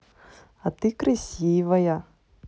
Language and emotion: Russian, positive